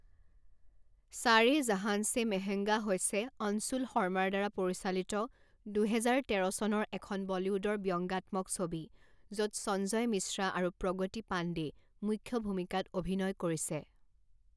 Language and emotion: Assamese, neutral